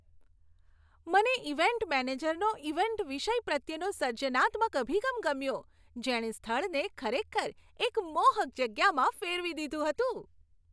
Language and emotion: Gujarati, happy